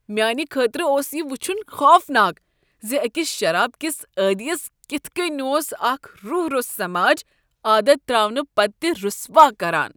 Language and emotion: Kashmiri, disgusted